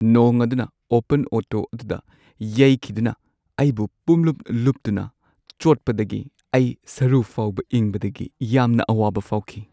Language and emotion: Manipuri, sad